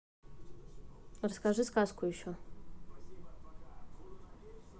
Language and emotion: Russian, neutral